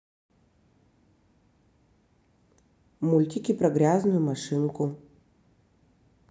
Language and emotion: Russian, neutral